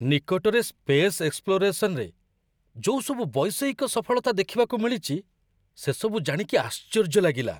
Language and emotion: Odia, surprised